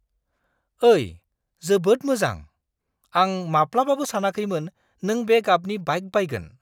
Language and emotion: Bodo, surprised